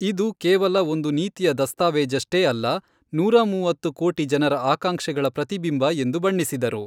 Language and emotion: Kannada, neutral